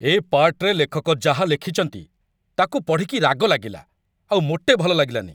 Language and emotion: Odia, angry